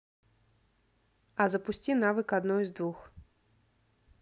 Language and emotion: Russian, neutral